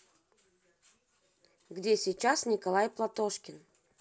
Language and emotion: Russian, neutral